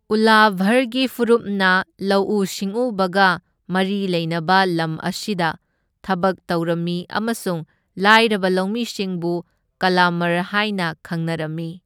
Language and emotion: Manipuri, neutral